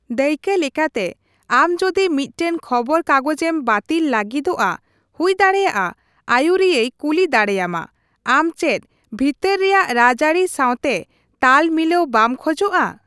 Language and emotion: Santali, neutral